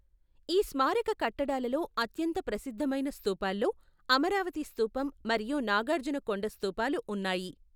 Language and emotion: Telugu, neutral